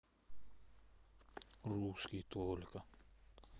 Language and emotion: Russian, sad